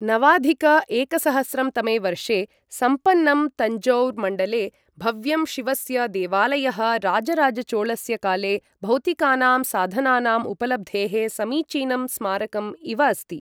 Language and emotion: Sanskrit, neutral